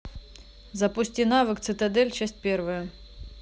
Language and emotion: Russian, neutral